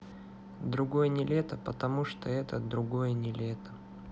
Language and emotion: Russian, sad